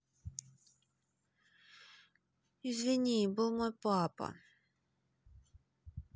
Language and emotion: Russian, neutral